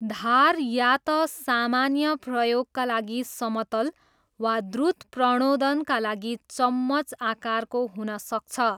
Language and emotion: Nepali, neutral